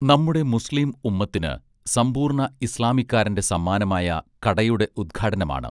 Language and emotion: Malayalam, neutral